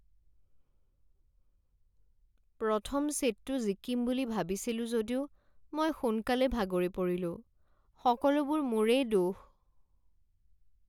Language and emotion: Assamese, sad